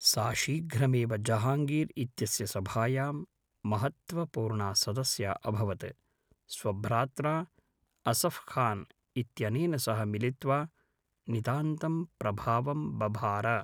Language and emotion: Sanskrit, neutral